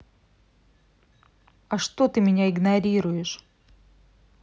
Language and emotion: Russian, angry